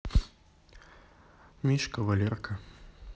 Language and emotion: Russian, neutral